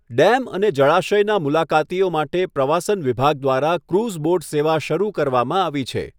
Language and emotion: Gujarati, neutral